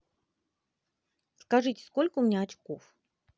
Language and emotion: Russian, positive